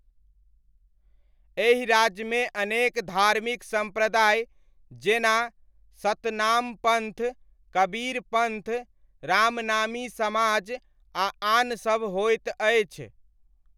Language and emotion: Maithili, neutral